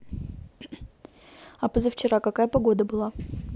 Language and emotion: Russian, neutral